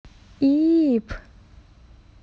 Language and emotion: Russian, neutral